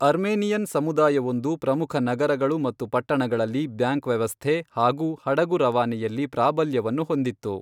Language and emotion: Kannada, neutral